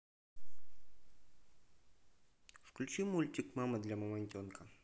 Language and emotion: Russian, neutral